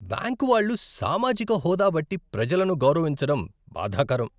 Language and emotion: Telugu, disgusted